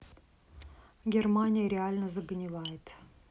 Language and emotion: Russian, neutral